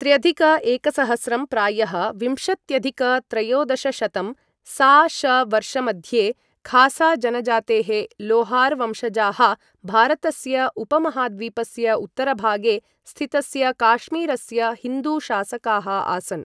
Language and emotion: Sanskrit, neutral